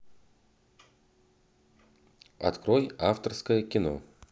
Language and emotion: Russian, neutral